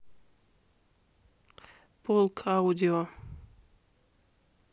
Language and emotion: Russian, neutral